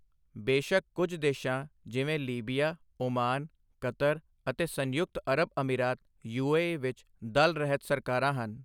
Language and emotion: Punjabi, neutral